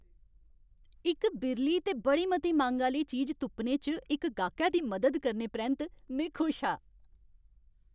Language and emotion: Dogri, happy